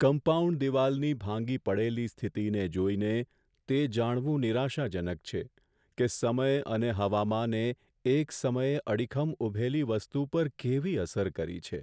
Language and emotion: Gujarati, sad